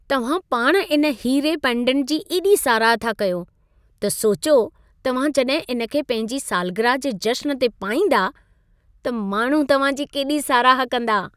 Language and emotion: Sindhi, happy